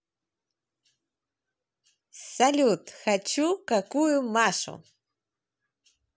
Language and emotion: Russian, positive